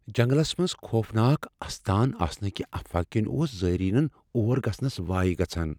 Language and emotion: Kashmiri, fearful